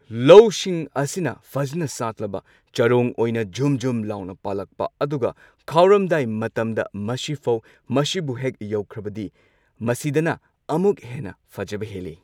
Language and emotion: Manipuri, neutral